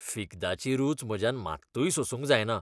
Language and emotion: Goan Konkani, disgusted